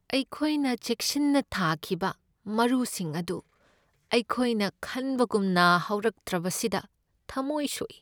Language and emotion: Manipuri, sad